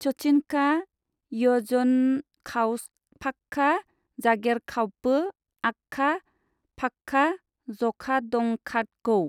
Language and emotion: Bodo, neutral